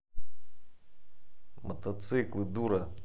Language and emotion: Russian, angry